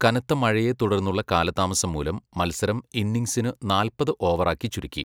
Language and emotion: Malayalam, neutral